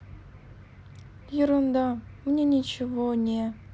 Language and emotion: Russian, sad